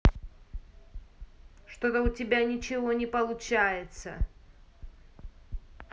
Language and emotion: Russian, angry